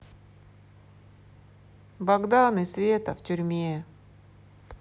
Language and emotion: Russian, sad